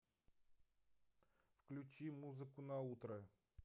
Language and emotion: Russian, neutral